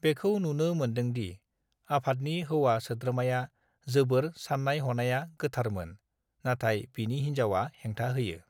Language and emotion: Bodo, neutral